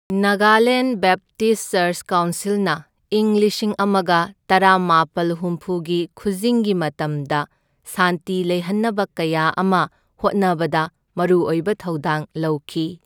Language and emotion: Manipuri, neutral